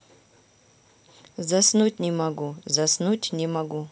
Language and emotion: Russian, neutral